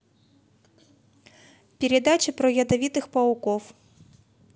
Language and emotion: Russian, neutral